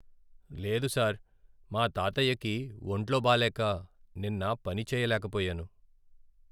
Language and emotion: Telugu, sad